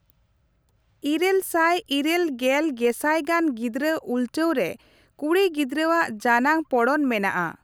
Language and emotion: Santali, neutral